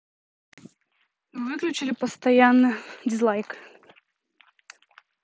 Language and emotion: Russian, neutral